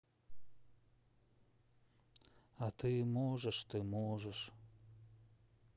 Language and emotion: Russian, sad